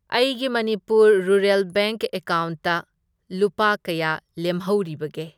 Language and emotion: Manipuri, neutral